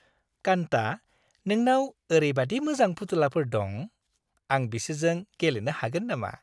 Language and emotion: Bodo, happy